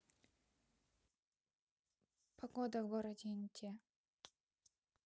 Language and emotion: Russian, neutral